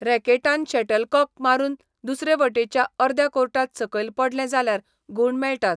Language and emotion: Goan Konkani, neutral